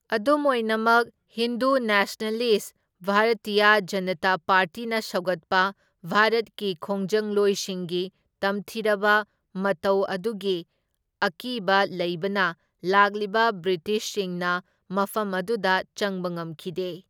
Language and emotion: Manipuri, neutral